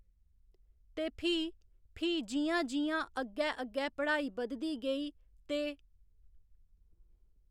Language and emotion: Dogri, neutral